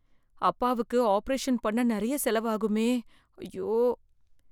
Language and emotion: Tamil, fearful